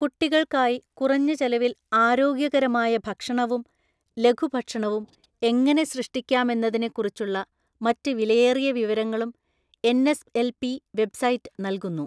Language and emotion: Malayalam, neutral